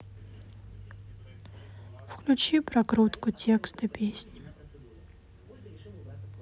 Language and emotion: Russian, sad